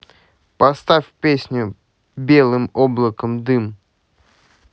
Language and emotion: Russian, neutral